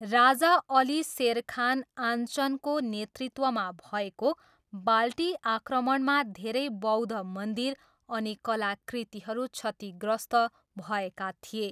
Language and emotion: Nepali, neutral